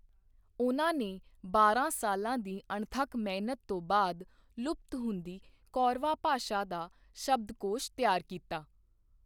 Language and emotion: Punjabi, neutral